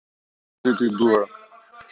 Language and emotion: Russian, neutral